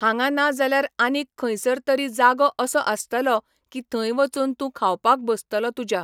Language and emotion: Goan Konkani, neutral